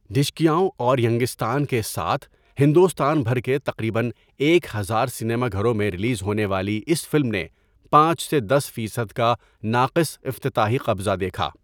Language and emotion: Urdu, neutral